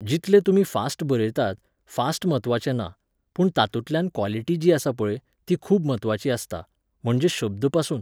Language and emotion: Goan Konkani, neutral